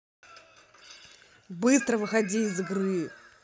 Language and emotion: Russian, angry